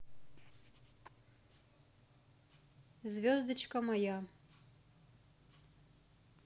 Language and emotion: Russian, neutral